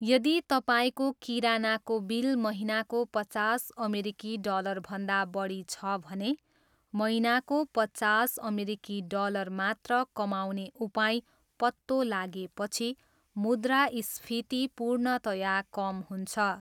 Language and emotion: Nepali, neutral